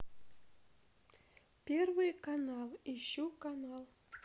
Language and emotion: Russian, neutral